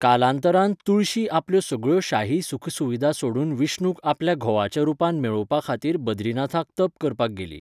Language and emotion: Goan Konkani, neutral